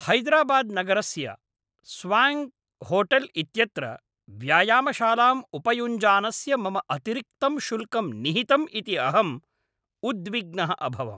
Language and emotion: Sanskrit, angry